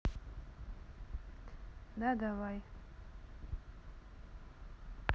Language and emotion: Russian, neutral